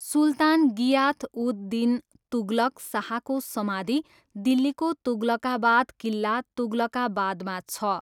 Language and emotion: Nepali, neutral